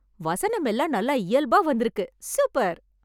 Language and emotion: Tamil, happy